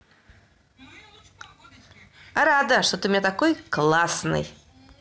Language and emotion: Russian, positive